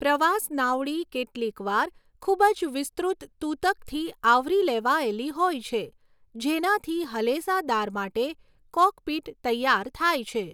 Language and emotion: Gujarati, neutral